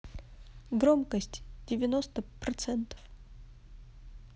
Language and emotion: Russian, neutral